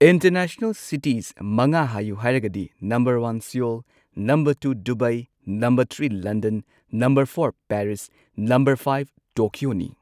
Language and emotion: Manipuri, neutral